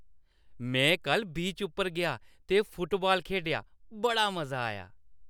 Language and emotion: Dogri, happy